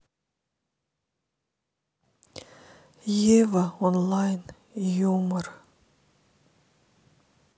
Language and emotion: Russian, sad